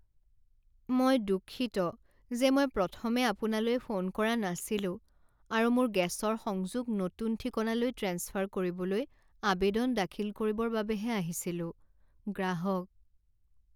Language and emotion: Assamese, sad